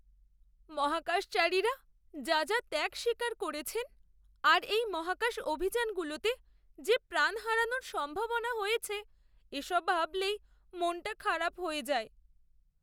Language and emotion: Bengali, sad